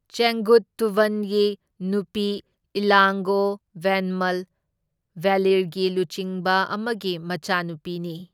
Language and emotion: Manipuri, neutral